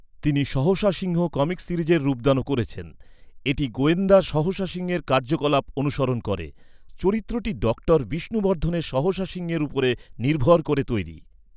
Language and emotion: Bengali, neutral